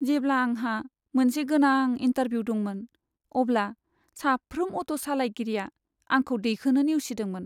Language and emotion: Bodo, sad